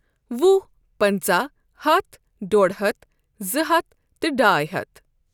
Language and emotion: Kashmiri, neutral